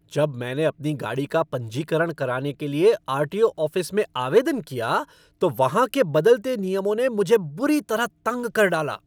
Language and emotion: Hindi, angry